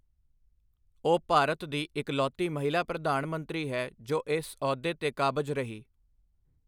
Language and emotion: Punjabi, neutral